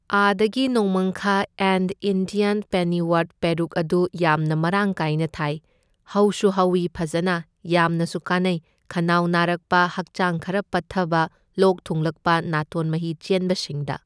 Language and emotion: Manipuri, neutral